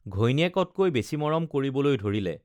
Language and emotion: Assamese, neutral